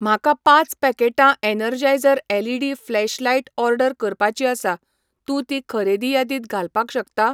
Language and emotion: Goan Konkani, neutral